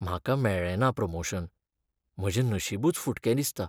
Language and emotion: Goan Konkani, sad